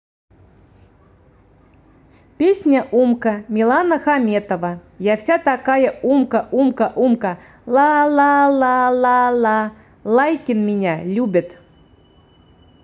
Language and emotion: Russian, positive